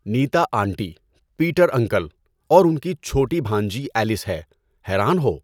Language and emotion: Urdu, neutral